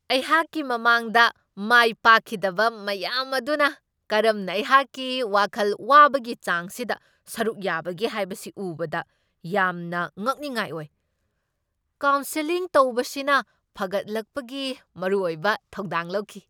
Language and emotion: Manipuri, surprised